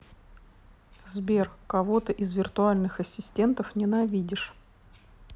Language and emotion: Russian, neutral